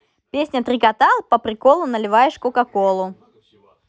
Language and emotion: Russian, positive